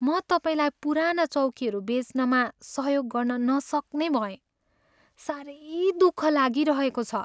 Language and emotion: Nepali, sad